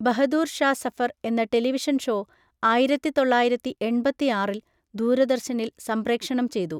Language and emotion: Malayalam, neutral